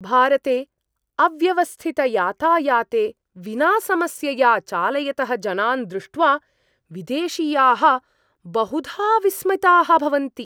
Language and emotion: Sanskrit, surprised